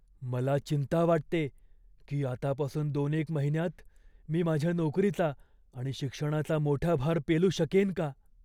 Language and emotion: Marathi, fearful